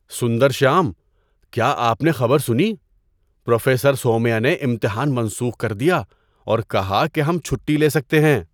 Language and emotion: Urdu, surprised